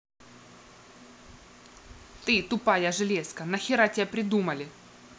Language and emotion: Russian, angry